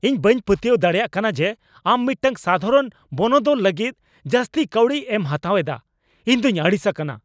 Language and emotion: Santali, angry